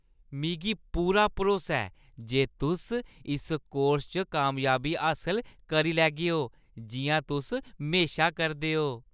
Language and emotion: Dogri, happy